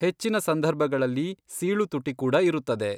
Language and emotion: Kannada, neutral